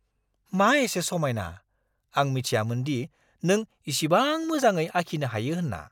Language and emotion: Bodo, surprised